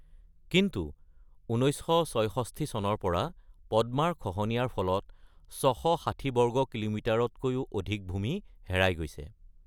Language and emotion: Assamese, neutral